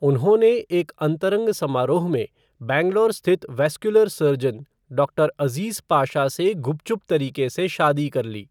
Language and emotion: Hindi, neutral